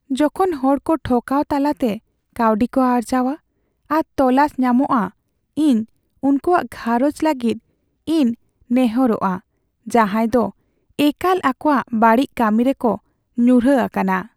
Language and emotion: Santali, sad